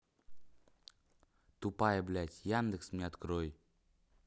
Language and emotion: Russian, angry